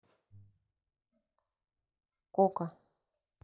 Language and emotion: Russian, neutral